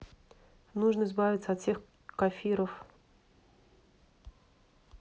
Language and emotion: Russian, neutral